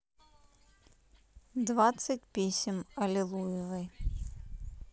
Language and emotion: Russian, neutral